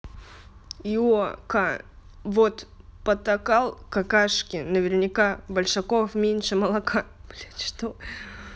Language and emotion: Russian, neutral